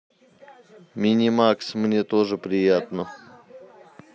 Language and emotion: Russian, neutral